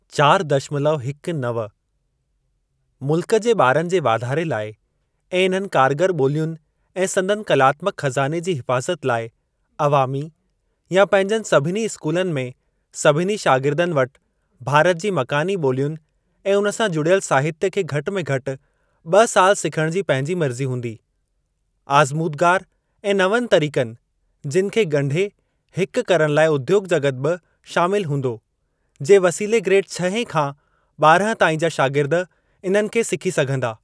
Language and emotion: Sindhi, neutral